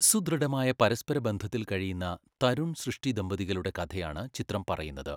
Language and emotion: Malayalam, neutral